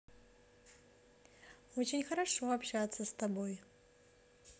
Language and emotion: Russian, positive